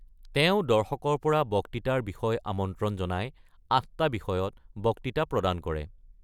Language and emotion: Assamese, neutral